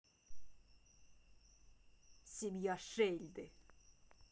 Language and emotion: Russian, angry